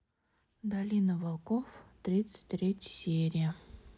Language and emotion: Russian, neutral